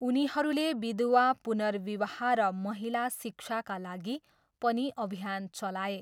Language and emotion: Nepali, neutral